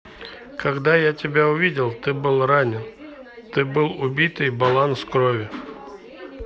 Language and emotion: Russian, neutral